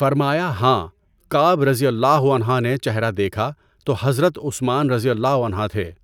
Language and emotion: Urdu, neutral